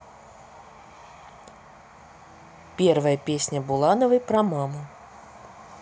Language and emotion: Russian, neutral